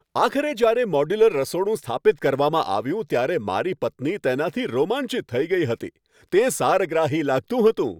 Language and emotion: Gujarati, happy